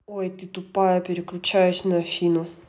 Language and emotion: Russian, angry